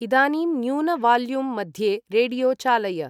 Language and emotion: Sanskrit, neutral